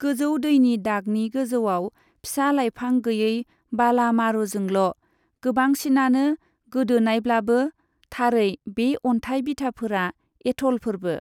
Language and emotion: Bodo, neutral